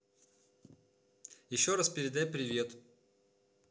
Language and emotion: Russian, neutral